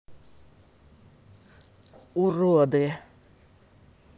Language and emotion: Russian, angry